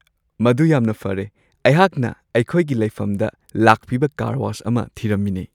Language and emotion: Manipuri, happy